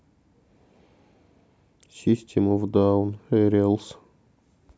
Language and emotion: Russian, sad